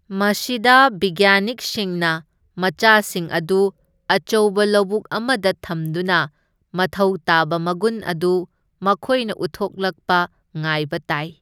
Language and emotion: Manipuri, neutral